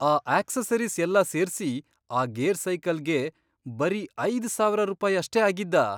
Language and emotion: Kannada, surprised